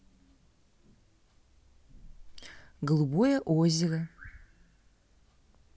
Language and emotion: Russian, neutral